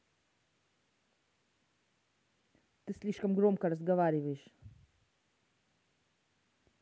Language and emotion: Russian, angry